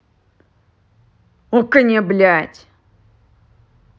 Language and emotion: Russian, angry